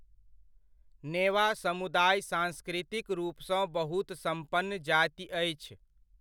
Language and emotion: Maithili, neutral